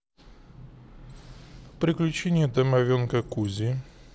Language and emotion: Russian, neutral